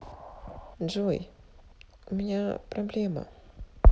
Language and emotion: Russian, neutral